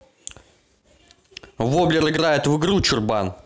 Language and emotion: Russian, angry